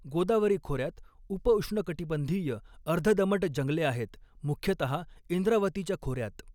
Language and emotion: Marathi, neutral